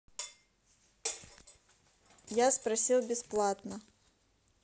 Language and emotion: Russian, neutral